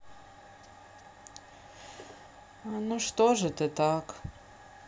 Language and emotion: Russian, sad